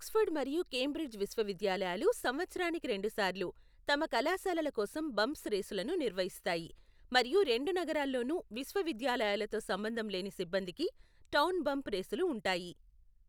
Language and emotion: Telugu, neutral